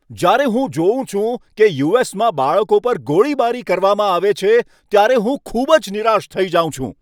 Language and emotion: Gujarati, angry